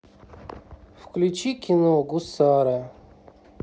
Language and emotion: Russian, neutral